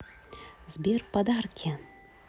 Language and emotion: Russian, positive